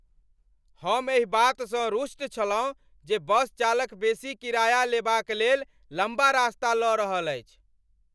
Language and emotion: Maithili, angry